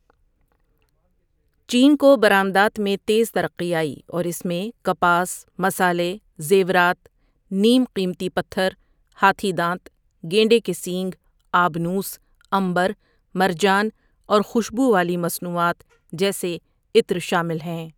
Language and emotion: Urdu, neutral